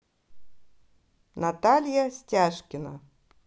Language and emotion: Russian, positive